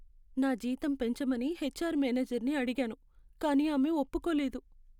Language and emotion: Telugu, sad